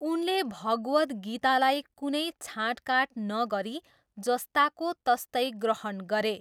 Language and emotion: Nepali, neutral